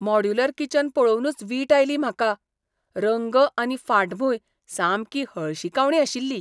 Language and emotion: Goan Konkani, disgusted